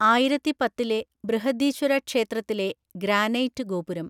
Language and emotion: Malayalam, neutral